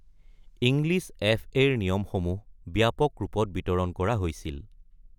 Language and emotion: Assamese, neutral